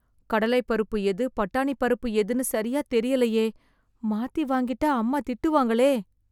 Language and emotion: Tamil, fearful